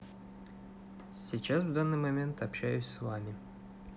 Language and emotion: Russian, neutral